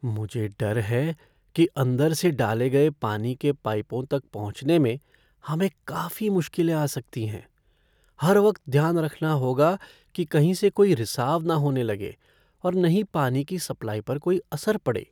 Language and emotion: Hindi, fearful